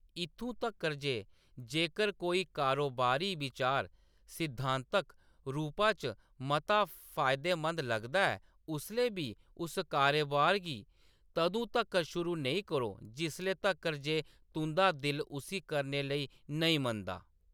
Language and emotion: Dogri, neutral